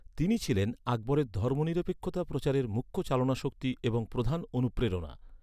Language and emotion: Bengali, neutral